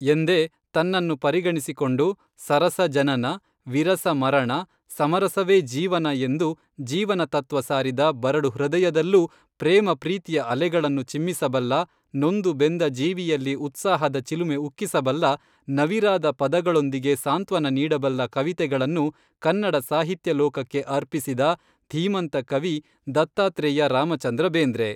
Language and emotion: Kannada, neutral